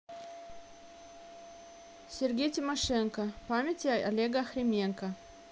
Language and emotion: Russian, neutral